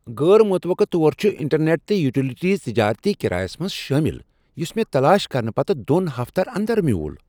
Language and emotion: Kashmiri, surprised